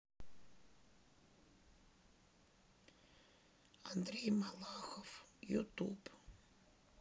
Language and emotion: Russian, sad